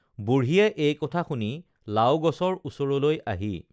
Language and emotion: Assamese, neutral